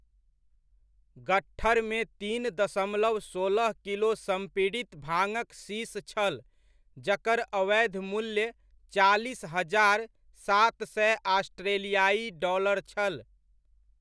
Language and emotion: Maithili, neutral